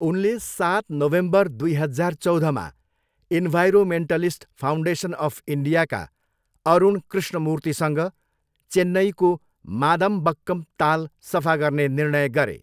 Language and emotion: Nepali, neutral